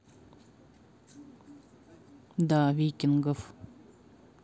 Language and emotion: Russian, neutral